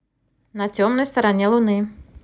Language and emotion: Russian, positive